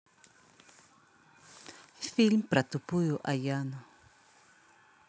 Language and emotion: Russian, neutral